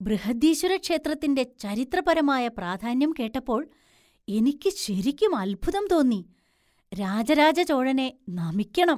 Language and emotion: Malayalam, surprised